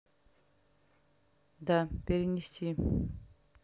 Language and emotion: Russian, neutral